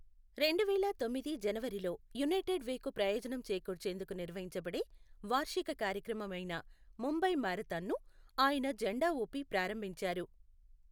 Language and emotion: Telugu, neutral